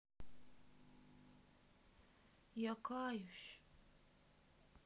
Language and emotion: Russian, sad